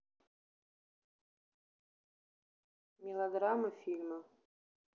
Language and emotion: Russian, neutral